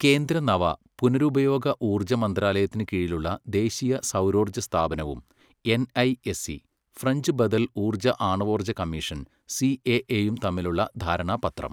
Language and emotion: Malayalam, neutral